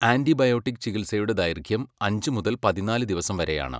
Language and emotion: Malayalam, neutral